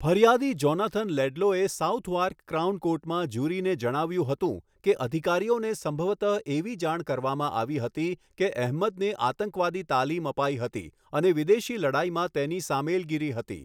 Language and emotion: Gujarati, neutral